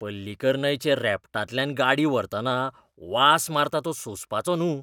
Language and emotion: Goan Konkani, disgusted